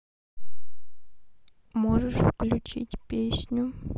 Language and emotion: Russian, sad